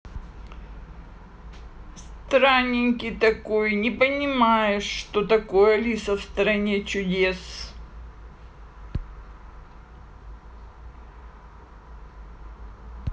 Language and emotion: Russian, neutral